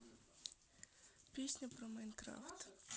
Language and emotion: Russian, neutral